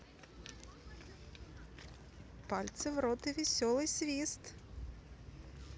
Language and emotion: Russian, positive